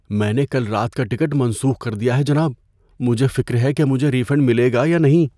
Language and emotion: Urdu, fearful